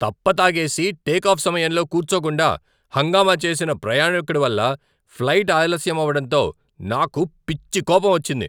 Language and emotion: Telugu, angry